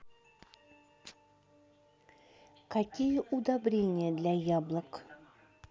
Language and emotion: Russian, neutral